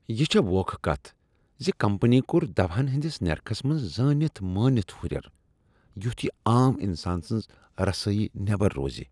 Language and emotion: Kashmiri, disgusted